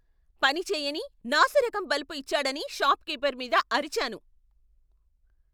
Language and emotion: Telugu, angry